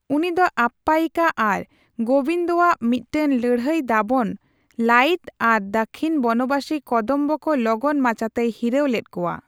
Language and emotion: Santali, neutral